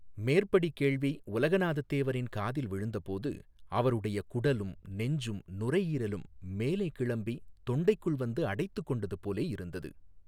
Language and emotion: Tamil, neutral